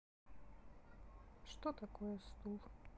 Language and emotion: Russian, sad